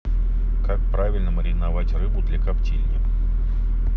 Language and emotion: Russian, neutral